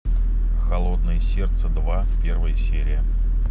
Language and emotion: Russian, neutral